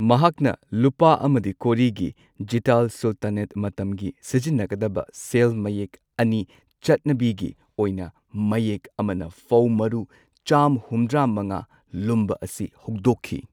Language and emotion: Manipuri, neutral